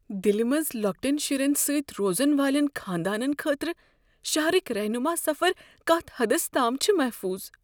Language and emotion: Kashmiri, fearful